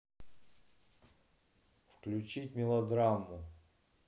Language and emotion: Russian, neutral